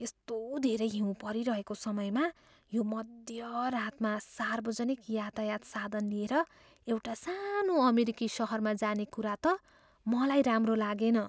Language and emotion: Nepali, fearful